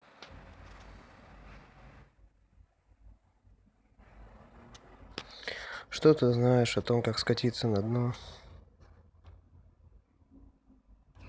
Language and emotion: Russian, sad